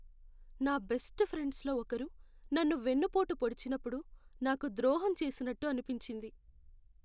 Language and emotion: Telugu, sad